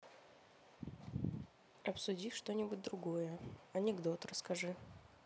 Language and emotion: Russian, neutral